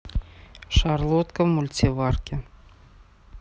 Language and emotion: Russian, neutral